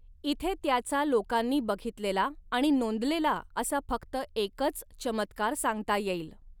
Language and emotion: Marathi, neutral